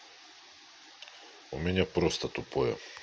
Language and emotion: Russian, angry